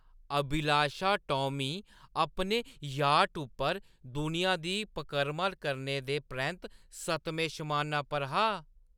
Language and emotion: Dogri, happy